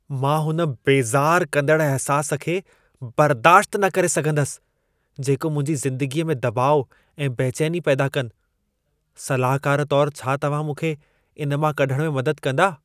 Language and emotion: Sindhi, disgusted